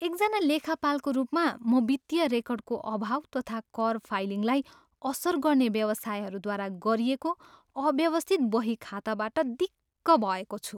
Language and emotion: Nepali, disgusted